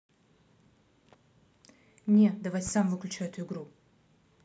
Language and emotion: Russian, angry